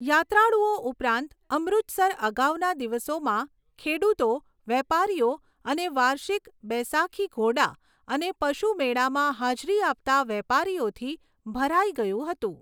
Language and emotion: Gujarati, neutral